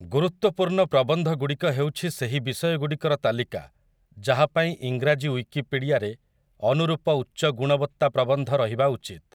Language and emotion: Odia, neutral